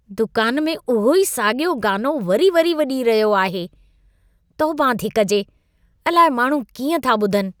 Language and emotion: Sindhi, disgusted